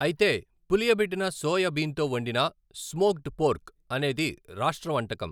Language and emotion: Telugu, neutral